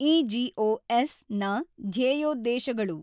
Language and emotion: Kannada, neutral